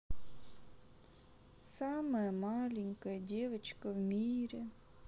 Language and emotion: Russian, sad